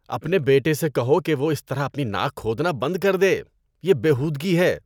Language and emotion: Urdu, disgusted